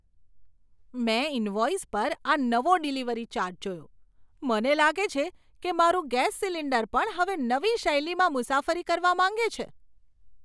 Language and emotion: Gujarati, surprised